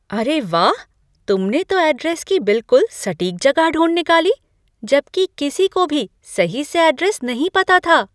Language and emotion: Hindi, surprised